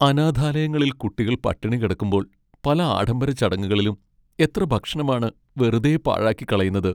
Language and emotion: Malayalam, sad